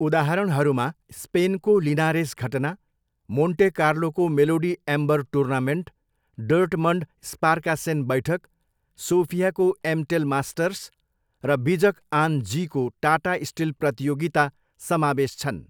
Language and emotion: Nepali, neutral